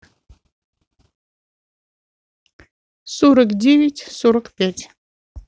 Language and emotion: Russian, neutral